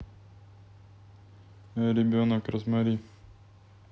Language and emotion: Russian, neutral